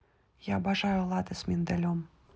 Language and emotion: Russian, positive